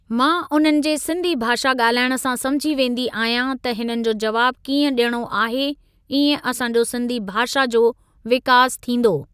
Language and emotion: Sindhi, neutral